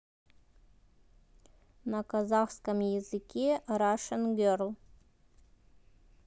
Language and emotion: Russian, neutral